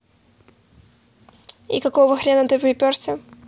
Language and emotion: Russian, neutral